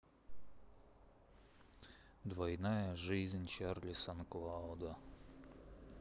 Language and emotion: Russian, sad